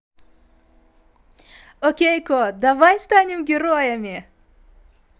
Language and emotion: Russian, positive